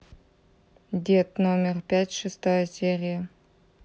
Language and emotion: Russian, neutral